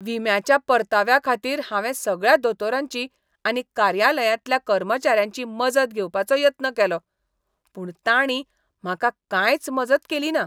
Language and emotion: Goan Konkani, disgusted